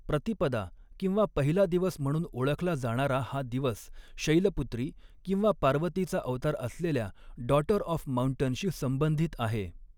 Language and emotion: Marathi, neutral